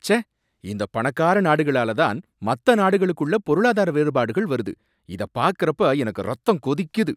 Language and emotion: Tamil, angry